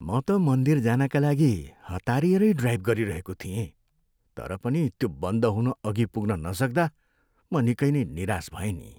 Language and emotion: Nepali, sad